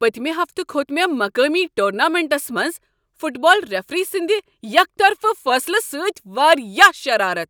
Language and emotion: Kashmiri, angry